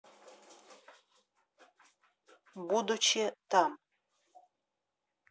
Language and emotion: Russian, neutral